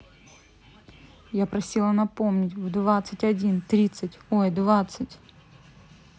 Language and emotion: Russian, angry